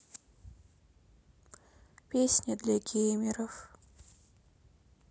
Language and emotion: Russian, sad